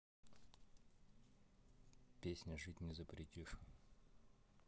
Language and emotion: Russian, neutral